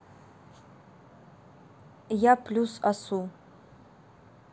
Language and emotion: Russian, neutral